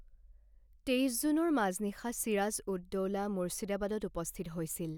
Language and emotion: Assamese, neutral